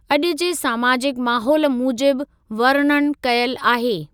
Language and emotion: Sindhi, neutral